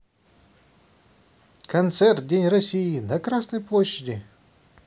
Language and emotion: Russian, neutral